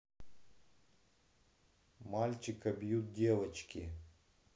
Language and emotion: Russian, neutral